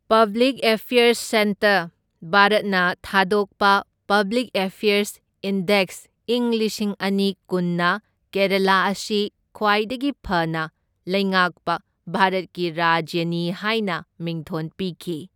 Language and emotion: Manipuri, neutral